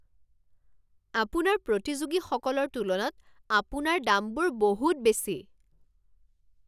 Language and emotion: Assamese, angry